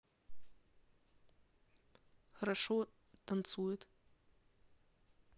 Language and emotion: Russian, neutral